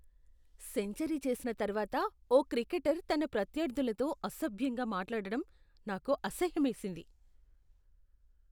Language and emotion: Telugu, disgusted